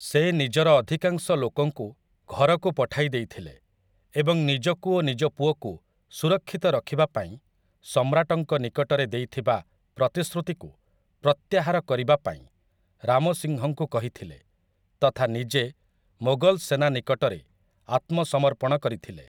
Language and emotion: Odia, neutral